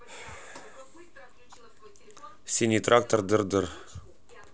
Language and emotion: Russian, neutral